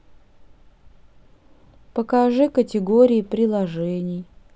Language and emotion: Russian, sad